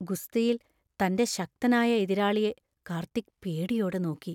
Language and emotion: Malayalam, fearful